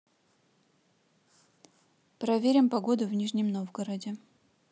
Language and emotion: Russian, neutral